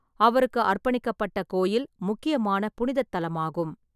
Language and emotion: Tamil, neutral